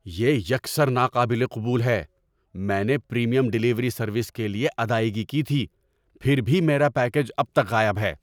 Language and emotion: Urdu, angry